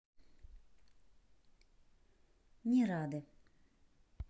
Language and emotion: Russian, neutral